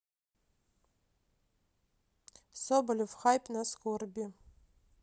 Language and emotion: Russian, neutral